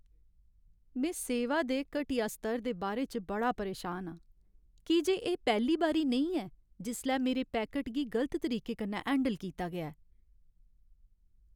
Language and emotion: Dogri, sad